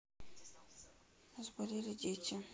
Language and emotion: Russian, sad